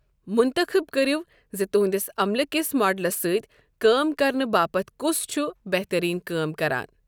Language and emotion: Kashmiri, neutral